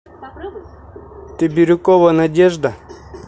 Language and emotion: Russian, neutral